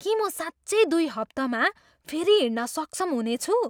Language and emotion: Nepali, surprised